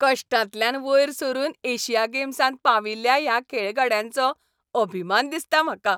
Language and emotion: Goan Konkani, happy